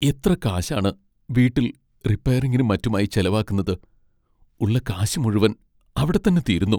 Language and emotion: Malayalam, sad